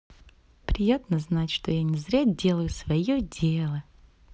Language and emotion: Russian, positive